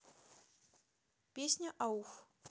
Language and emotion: Russian, neutral